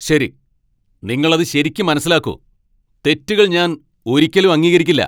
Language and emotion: Malayalam, angry